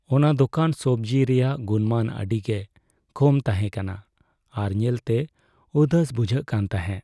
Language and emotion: Santali, sad